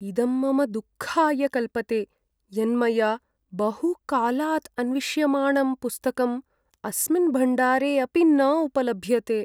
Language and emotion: Sanskrit, sad